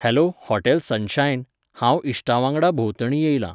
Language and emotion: Goan Konkani, neutral